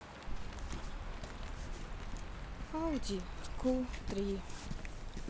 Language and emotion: Russian, sad